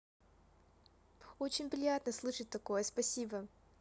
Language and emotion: Russian, positive